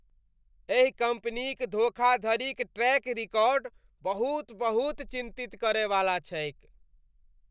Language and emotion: Maithili, disgusted